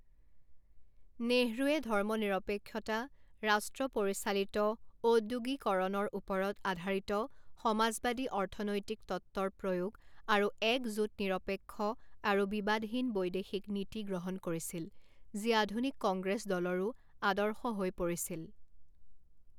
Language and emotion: Assamese, neutral